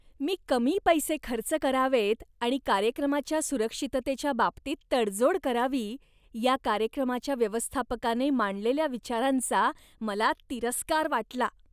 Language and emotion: Marathi, disgusted